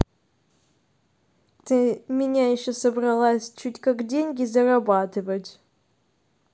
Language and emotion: Russian, neutral